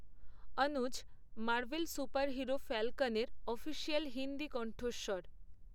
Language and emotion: Bengali, neutral